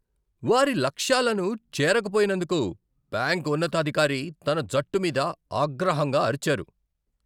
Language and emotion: Telugu, angry